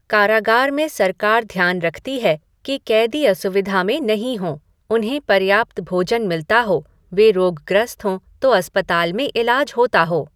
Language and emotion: Hindi, neutral